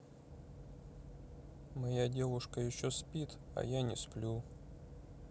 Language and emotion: Russian, sad